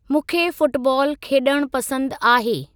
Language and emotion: Sindhi, neutral